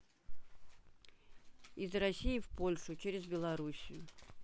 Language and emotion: Russian, neutral